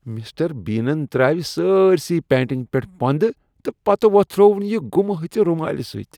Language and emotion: Kashmiri, disgusted